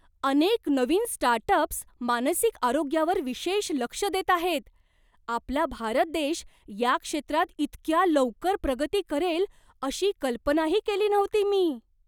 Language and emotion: Marathi, surprised